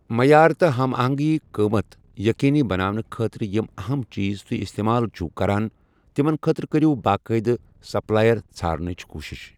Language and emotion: Kashmiri, neutral